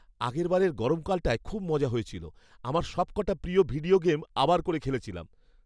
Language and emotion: Bengali, happy